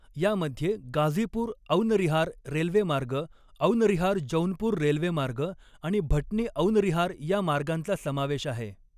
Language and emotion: Marathi, neutral